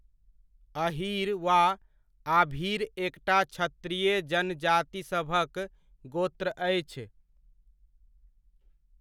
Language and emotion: Maithili, neutral